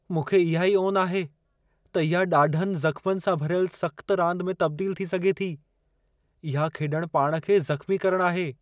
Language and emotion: Sindhi, fearful